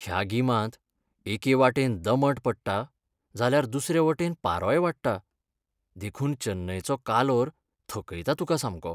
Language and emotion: Goan Konkani, sad